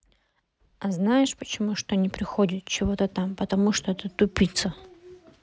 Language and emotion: Russian, neutral